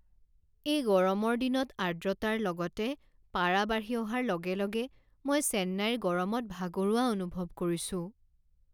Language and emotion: Assamese, sad